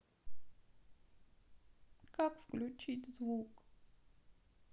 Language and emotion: Russian, sad